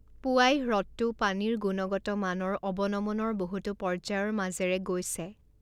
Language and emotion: Assamese, neutral